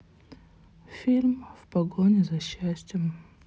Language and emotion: Russian, sad